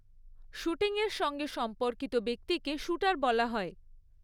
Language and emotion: Bengali, neutral